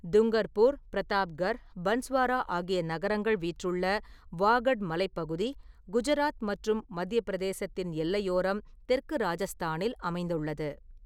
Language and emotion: Tamil, neutral